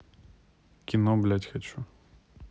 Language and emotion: Russian, angry